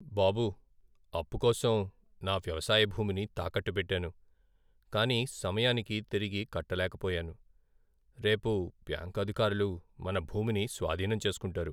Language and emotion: Telugu, sad